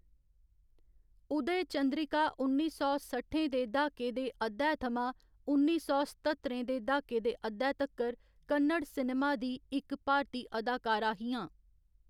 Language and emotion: Dogri, neutral